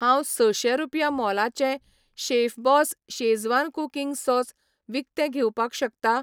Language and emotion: Goan Konkani, neutral